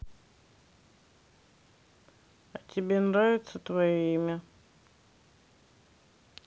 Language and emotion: Russian, neutral